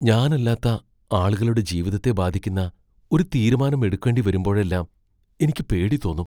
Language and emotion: Malayalam, fearful